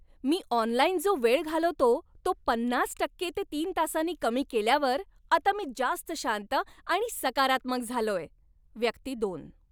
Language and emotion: Marathi, happy